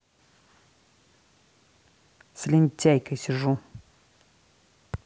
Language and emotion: Russian, angry